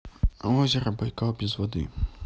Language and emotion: Russian, neutral